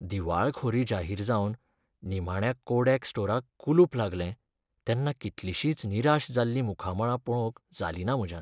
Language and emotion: Goan Konkani, sad